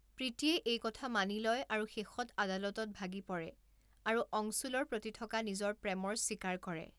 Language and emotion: Assamese, neutral